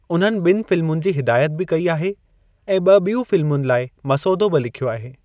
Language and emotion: Sindhi, neutral